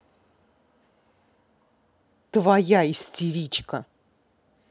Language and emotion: Russian, angry